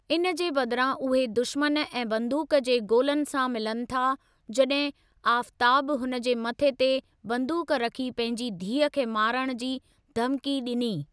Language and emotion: Sindhi, neutral